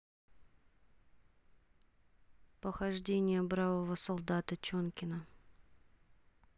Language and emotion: Russian, neutral